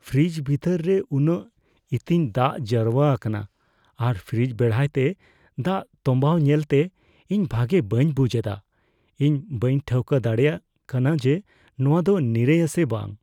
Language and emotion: Santali, fearful